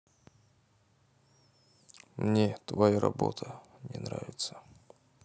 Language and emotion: Russian, sad